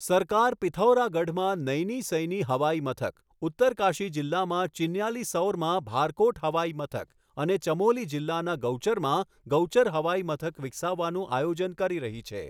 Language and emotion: Gujarati, neutral